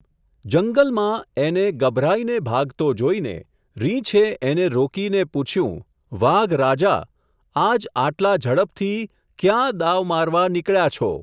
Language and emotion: Gujarati, neutral